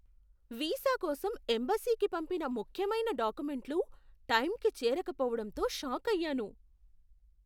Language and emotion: Telugu, surprised